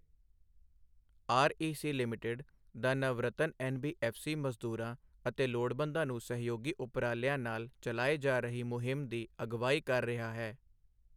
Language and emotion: Punjabi, neutral